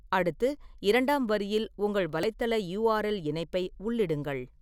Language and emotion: Tamil, neutral